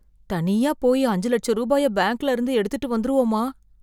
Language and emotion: Tamil, fearful